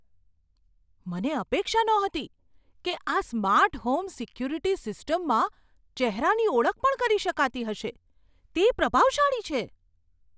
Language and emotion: Gujarati, surprised